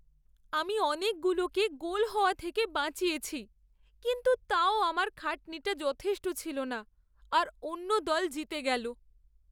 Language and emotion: Bengali, sad